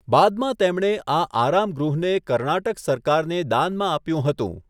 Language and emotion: Gujarati, neutral